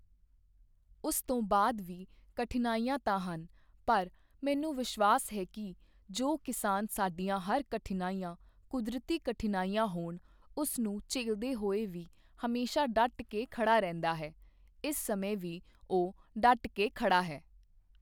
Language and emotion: Punjabi, neutral